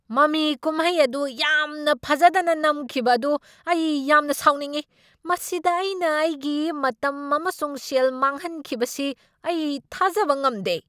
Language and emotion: Manipuri, angry